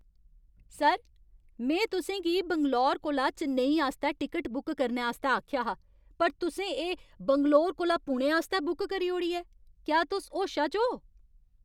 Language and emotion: Dogri, angry